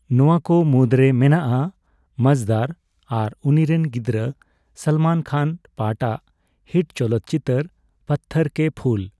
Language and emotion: Santali, neutral